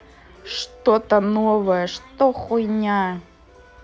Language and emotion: Russian, angry